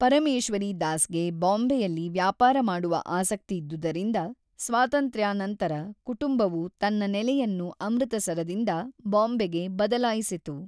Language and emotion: Kannada, neutral